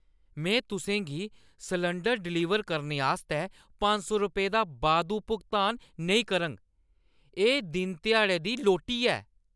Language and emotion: Dogri, angry